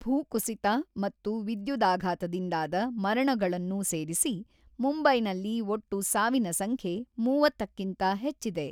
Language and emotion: Kannada, neutral